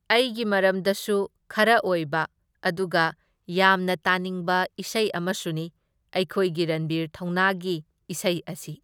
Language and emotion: Manipuri, neutral